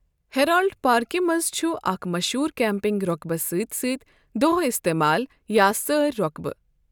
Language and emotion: Kashmiri, neutral